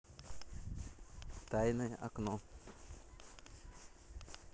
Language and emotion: Russian, neutral